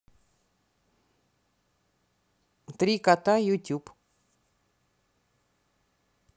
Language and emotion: Russian, neutral